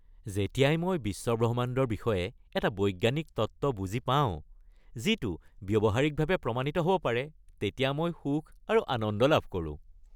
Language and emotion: Assamese, happy